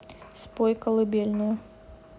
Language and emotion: Russian, neutral